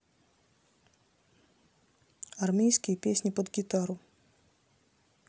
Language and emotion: Russian, neutral